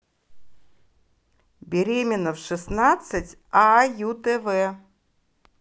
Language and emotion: Russian, positive